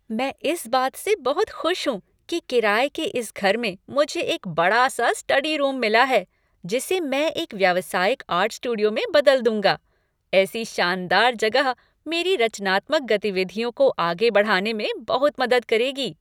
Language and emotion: Hindi, happy